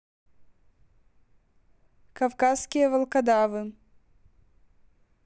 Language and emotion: Russian, neutral